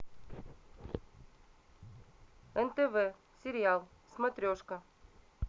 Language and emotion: Russian, neutral